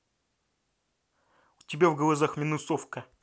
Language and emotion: Russian, angry